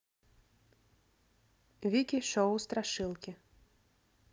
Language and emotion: Russian, neutral